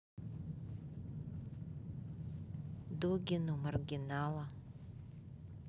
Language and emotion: Russian, neutral